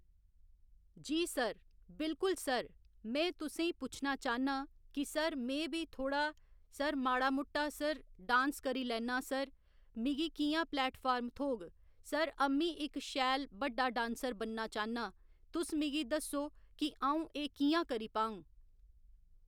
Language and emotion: Dogri, neutral